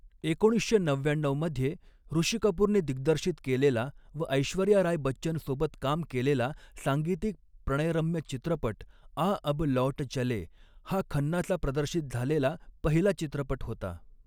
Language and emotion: Marathi, neutral